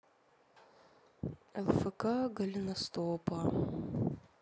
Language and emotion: Russian, sad